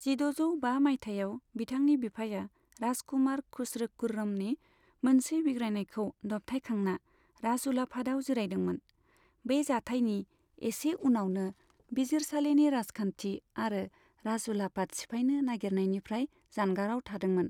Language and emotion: Bodo, neutral